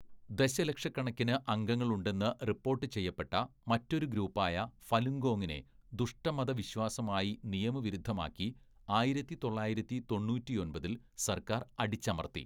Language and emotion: Malayalam, neutral